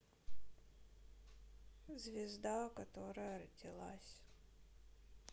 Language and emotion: Russian, sad